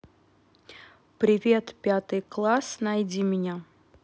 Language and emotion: Russian, neutral